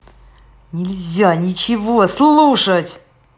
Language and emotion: Russian, angry